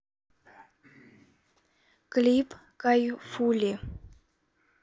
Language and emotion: Russian, neutral